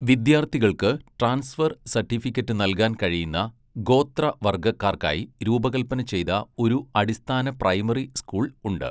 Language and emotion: Malayalam, neutral